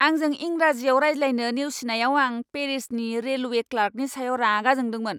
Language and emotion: Bodo, angry